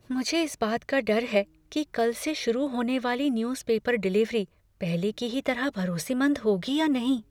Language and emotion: Hindi, fearful